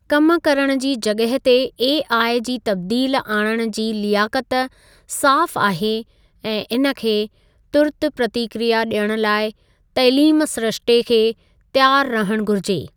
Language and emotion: Sindhi, neutral